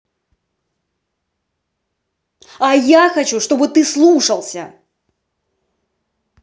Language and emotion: Russian, angry